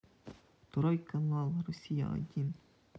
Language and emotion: Russian, neutral